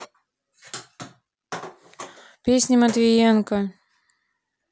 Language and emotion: Russian, neutral